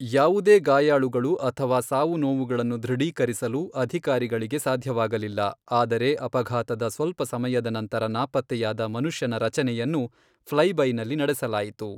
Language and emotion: Kannada, neutral